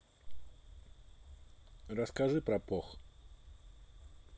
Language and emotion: Russian, neutral